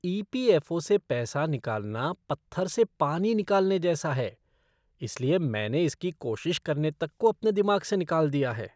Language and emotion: Hindi, disgusted